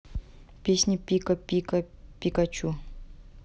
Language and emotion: Russian, neutral